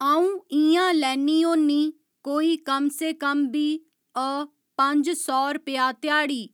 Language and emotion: Dogri, neutral